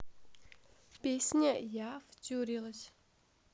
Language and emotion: Russian, neutral